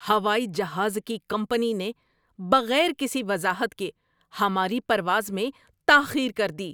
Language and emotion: Urdu, angry